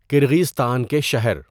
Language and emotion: Urdu, neutral